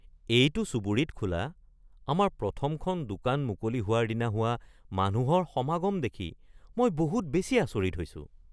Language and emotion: Assamese, surprised